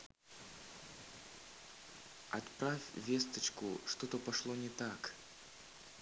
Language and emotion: Russian, neutral